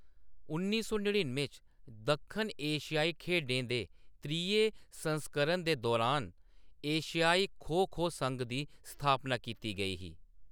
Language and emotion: Dogri, neutral